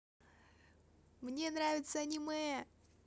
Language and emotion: Russian, positive